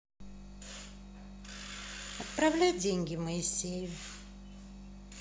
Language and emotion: Russian, neutral